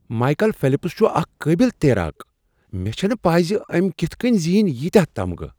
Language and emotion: Kashmiri, surprised